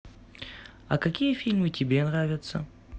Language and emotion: Russian, neutral